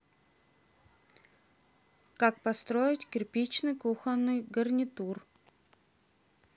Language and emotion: Russian, neutral